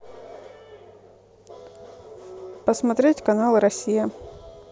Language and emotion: Russian, neutral